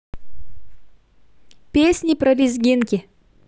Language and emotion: Russian, positive